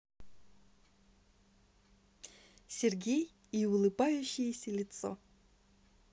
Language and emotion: Russian, positive